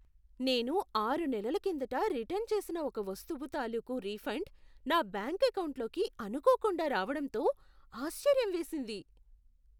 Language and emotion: Telugu, surprised